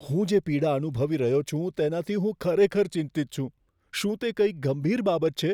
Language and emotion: Gujarati, fearful